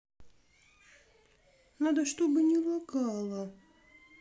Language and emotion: Russian, sad